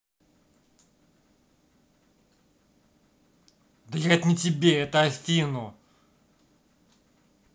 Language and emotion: Russian, angry